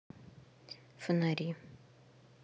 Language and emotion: Russian, neutral